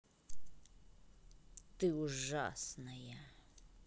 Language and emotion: Russian, angry